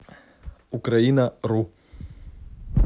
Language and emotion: Russian, neutral